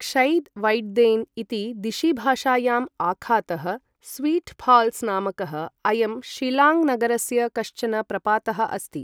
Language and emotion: Sanskrit, neutral